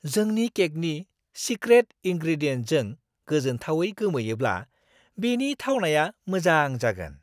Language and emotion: Bodo, surprised